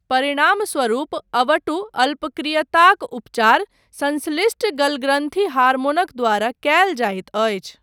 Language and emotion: Maithili, neutral